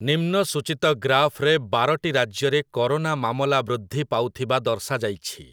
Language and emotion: Odia, neutral